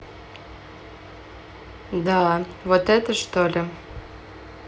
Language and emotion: Russian, neutral